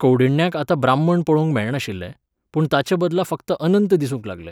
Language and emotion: Goan Konkani, neutral